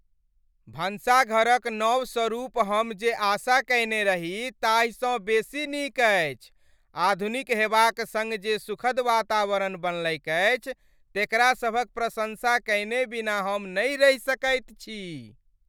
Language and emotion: Maithili, happy